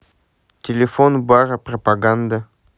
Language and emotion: Russian, neutral